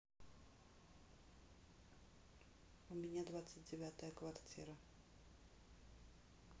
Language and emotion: Russian, neutral